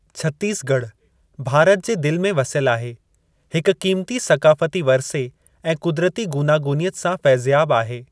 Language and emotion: Sindhi, neutral